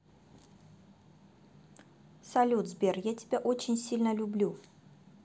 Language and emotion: Russian, positive